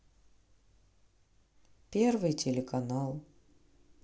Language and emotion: Russian, sad